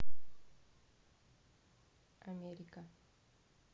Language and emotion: Russian, neutral